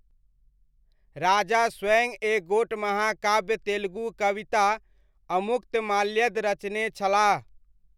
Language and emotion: Maithili, neutral